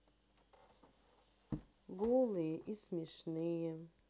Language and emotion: Russian, sad